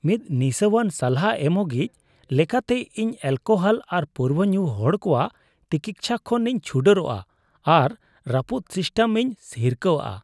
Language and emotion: Santali, disgusted